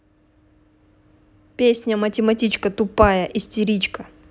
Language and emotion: Russian, angry